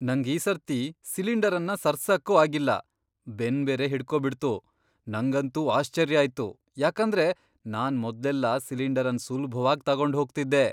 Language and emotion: Kannada, surprised